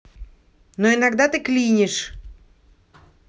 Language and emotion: Russian, angry